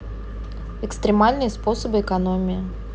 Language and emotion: Russian, neutral